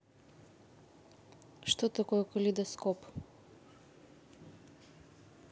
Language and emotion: Russian, neutral